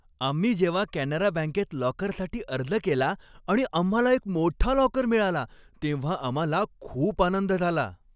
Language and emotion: Marathi, happy